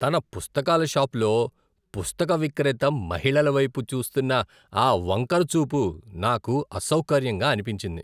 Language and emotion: Telugu, disgusted